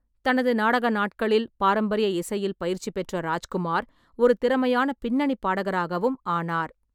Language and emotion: Tamil, neutral